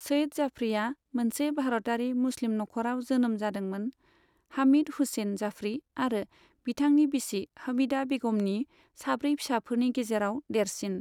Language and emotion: Bodo, neutral